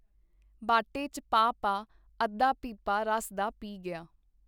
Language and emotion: Punjabi, neutral